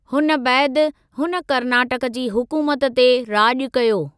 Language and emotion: Sindhi, neutral